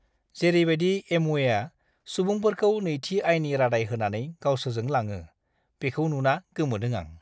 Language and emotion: Bodo, disgusted